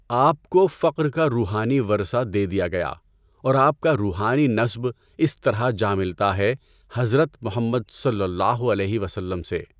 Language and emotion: Urdu, neutral